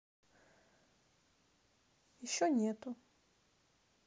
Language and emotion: Russian, neutral